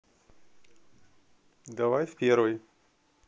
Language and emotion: Russian, neutral